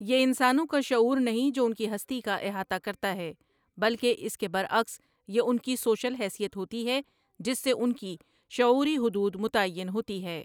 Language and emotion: Urdu, neutral